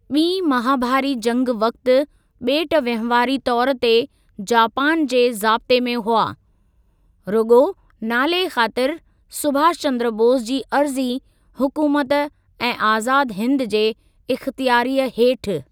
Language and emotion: Sindhi, neutral